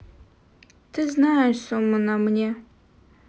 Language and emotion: Russian, sad